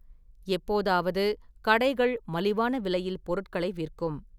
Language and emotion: Tamil, neutral